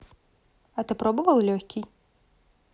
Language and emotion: Russian, neutral